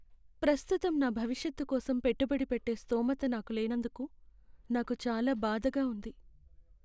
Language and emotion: Telugu, sad